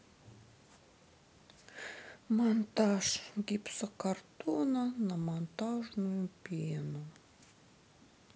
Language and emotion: Russian, sad